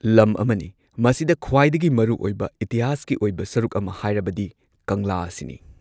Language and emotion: Manipuri, neutral